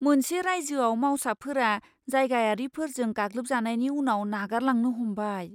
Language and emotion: Bodo, fearful